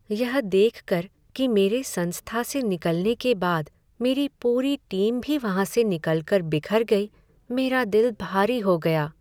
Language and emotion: Hindi, sad